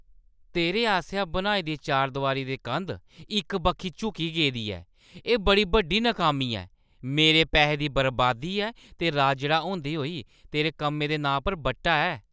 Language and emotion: Dogri, angry